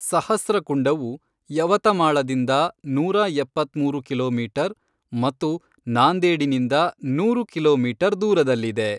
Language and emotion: Kannada, neutral